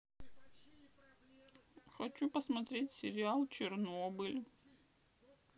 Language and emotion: Russian, sad